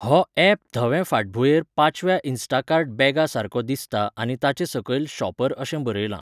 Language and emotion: Goan Konkani, neutral